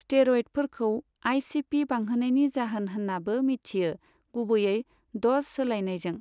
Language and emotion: Bodo, neutral